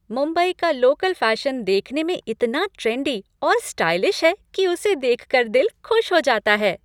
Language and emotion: Hindi, happy